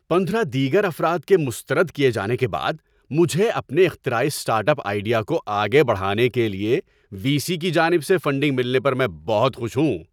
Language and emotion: Urdu, happy